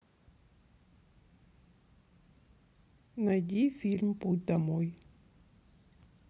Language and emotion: Russian, neutral